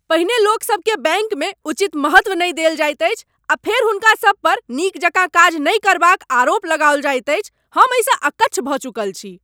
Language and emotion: Maithili, angry